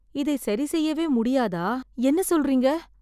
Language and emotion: Tamil, sad